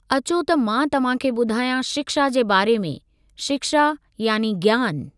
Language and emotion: Sindhi, neutral